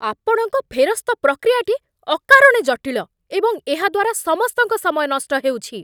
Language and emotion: Odia, angry